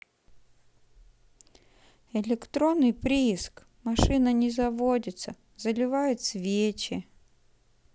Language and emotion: Russian, sad